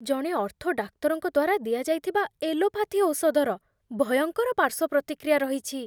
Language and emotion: Odia, fearful